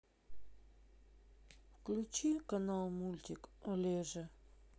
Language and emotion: Russian, sad